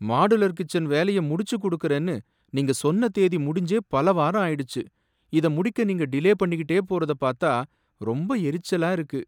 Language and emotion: Tamil, angry